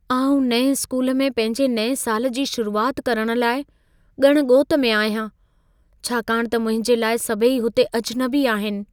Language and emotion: Sindhi, fearful